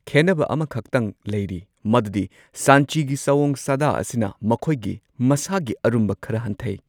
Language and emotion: Manipuri, neutral